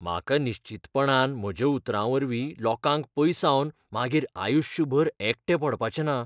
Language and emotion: Goan Konkani, fearful